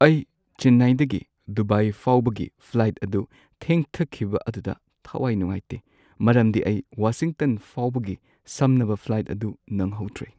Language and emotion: Manipuri, sad